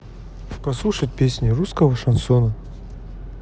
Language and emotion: Russian, neutral